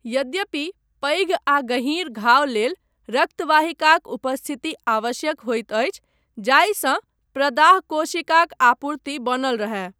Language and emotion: Maithili, neutral